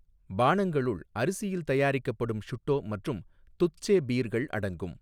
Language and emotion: Tamil, neutral